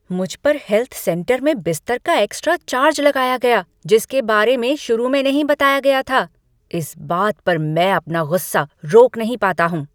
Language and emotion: Hindi, angry